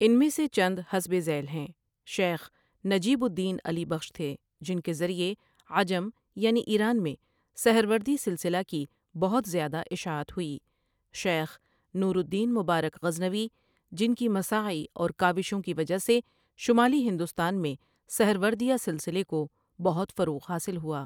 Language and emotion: Urdu, neutral